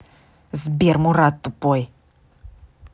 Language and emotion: Russian, angry